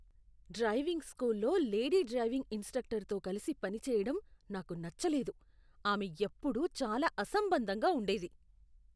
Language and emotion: Telugu, disgusted